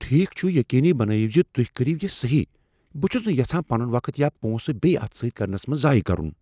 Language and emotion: Kashmiri, fearful